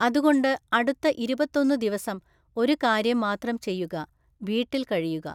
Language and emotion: Malayalam, neutral